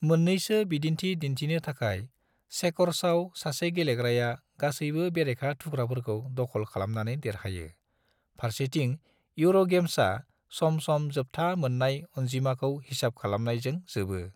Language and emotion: Bodo, neutral